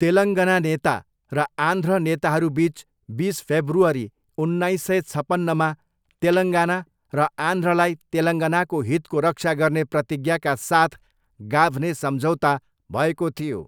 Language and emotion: Nepali, neutral